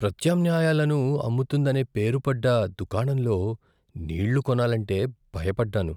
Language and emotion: Telugu, fearful